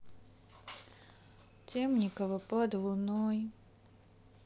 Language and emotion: Russian, sad